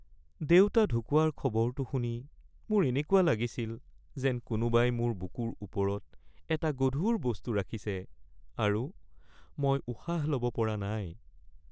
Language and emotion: Assamese, sad